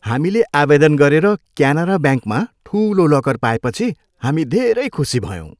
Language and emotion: Nepali, happy